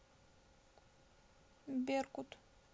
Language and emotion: Russian, sad